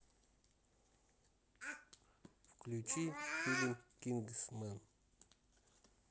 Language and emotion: Russian, neutral